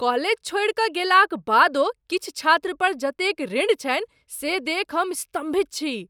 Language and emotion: Maithili, surprised